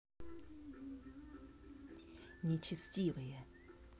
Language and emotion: Russian, angry